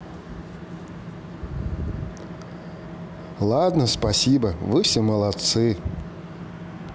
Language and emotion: Russian, neutral